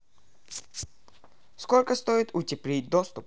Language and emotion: Russian, neutral